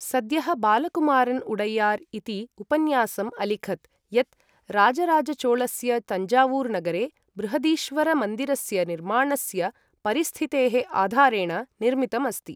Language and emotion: Sanskrit, neutral